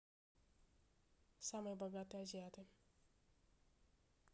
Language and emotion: Russian, neutral